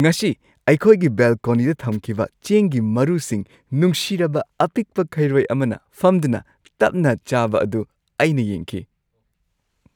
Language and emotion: Manipuri, happy